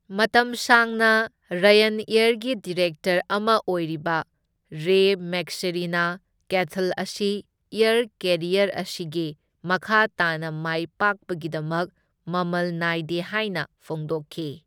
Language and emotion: Manipuri, neutral